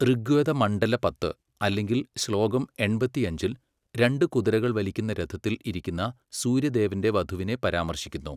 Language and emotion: Malayalam, neutral